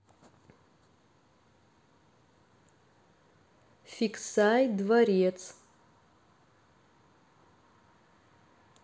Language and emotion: Russian, neutral